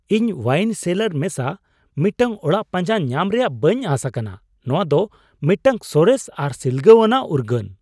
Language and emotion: Santali, surprised